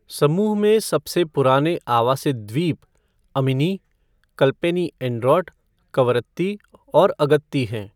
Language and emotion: Hindi, neutral